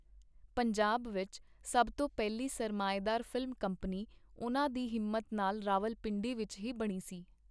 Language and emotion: Punjabi, neutral